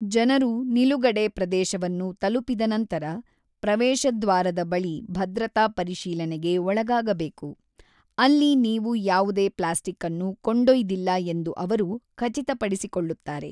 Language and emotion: Kannada, neutral